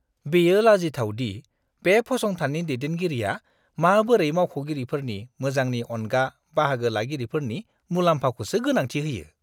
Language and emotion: Bodo, disgusted